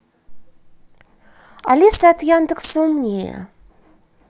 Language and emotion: Russian, neutral